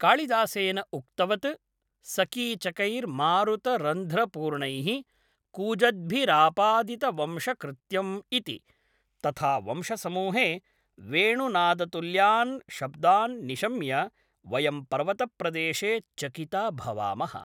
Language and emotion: Sanskrit, neutral